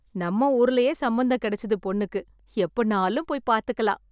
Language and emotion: Tamil, happy